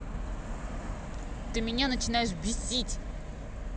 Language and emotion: Russian, angry